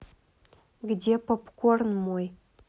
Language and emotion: Russian, angry